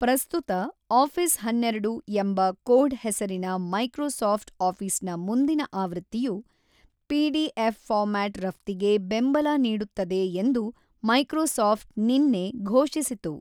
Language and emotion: Kannada, neutral